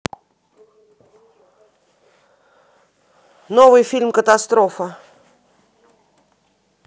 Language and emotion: Russian, neutral